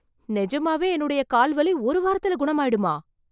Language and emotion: Tamil, surprised